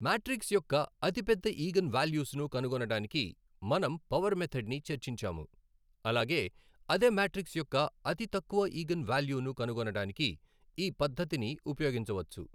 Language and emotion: Telugu, neutral